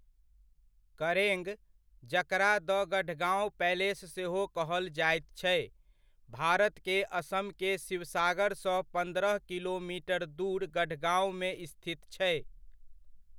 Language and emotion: Maithili, neutral